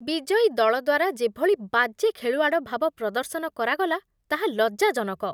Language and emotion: Odia, disgusted